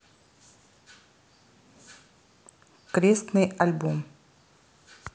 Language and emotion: Russian, neutral